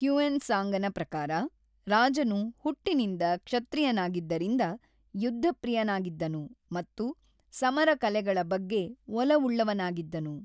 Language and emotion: Kannada, neutral